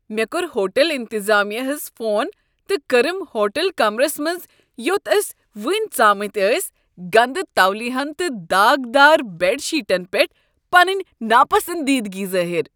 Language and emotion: Kashmiri, disgusted